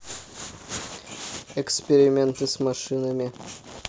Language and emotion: Russian, neutral